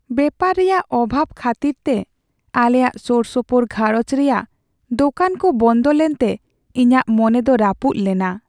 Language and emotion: Santali, sad